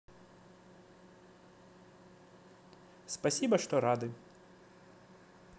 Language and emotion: Russian, positive